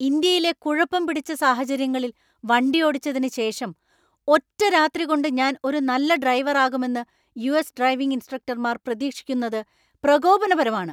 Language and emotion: Malayalam, angry